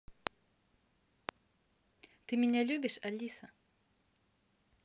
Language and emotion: Russian, neutral